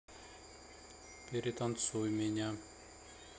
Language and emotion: Russian, neutral